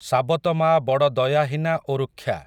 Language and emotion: Odia, neutral